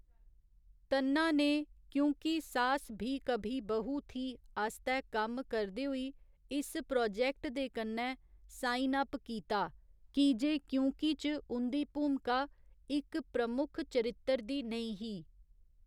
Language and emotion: Dogri, neutral